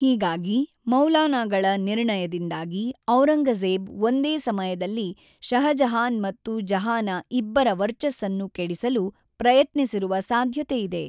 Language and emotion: Kannada, neutral